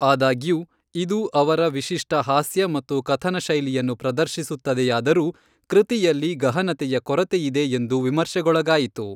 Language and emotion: Kannada, neutral